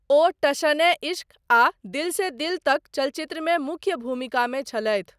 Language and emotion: Maithili, neutral